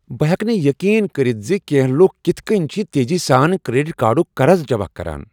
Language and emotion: Kashmiri, surprised